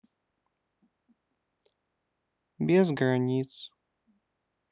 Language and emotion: Russian, sad